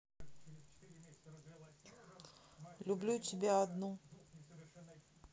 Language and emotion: Russian, neutral